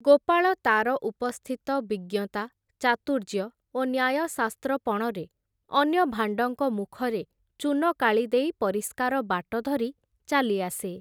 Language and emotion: Odia, neutral